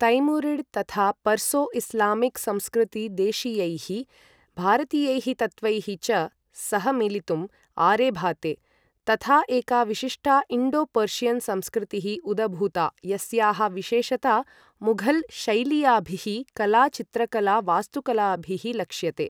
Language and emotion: Sanskrit, neutral